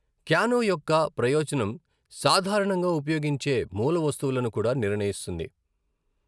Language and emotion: Telugu, neutral